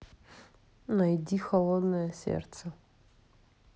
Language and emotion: Russian, neutral